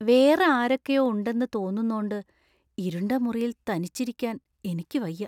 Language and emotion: Malayalam, fearful